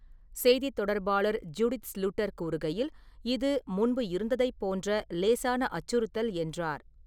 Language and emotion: Tamil, neutral